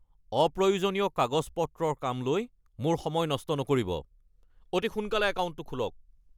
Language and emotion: Assamese, angry